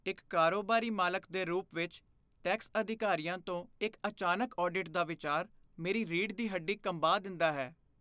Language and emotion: Punjabi, fearful